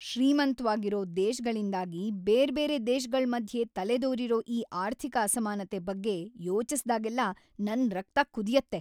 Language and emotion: Kannada, angry